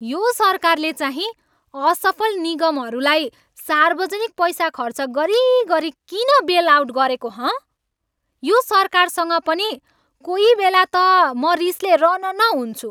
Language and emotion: Nepali, angry